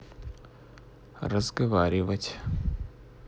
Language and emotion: Russian, neutral